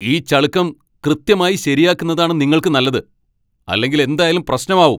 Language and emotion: Malayalam, angry